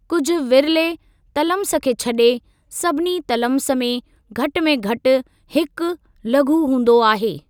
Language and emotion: Sindhi, neutral